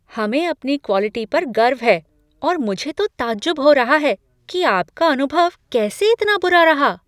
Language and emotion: Hindi, surprised